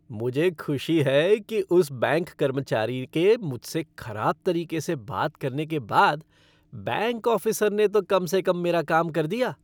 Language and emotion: Hindi, happy